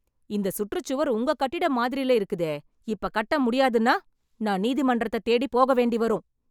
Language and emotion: Tamil, angry